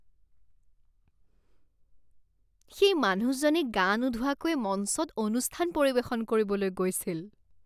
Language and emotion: Assamese, disgusted